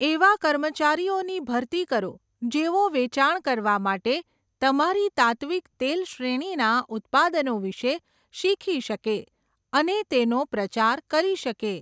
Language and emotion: Gujarati, neutral